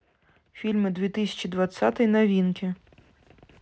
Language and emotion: Russian, neutral